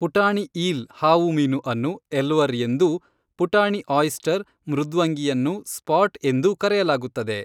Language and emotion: Kannada, neutral